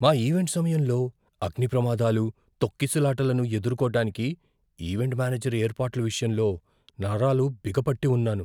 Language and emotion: Telugu, fearful